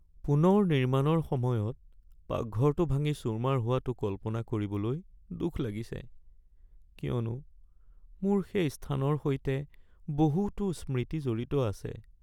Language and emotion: Assamese, sad